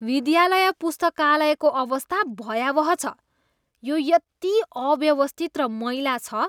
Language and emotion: Nepali, disgusted